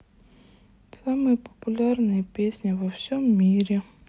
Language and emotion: Russian, sad